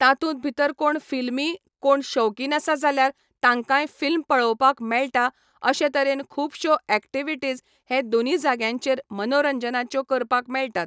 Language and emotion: Goan Konkani, neutral